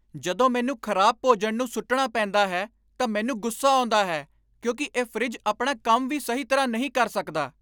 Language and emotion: Punjabi, angry